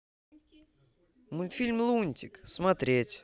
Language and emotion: Russian, positive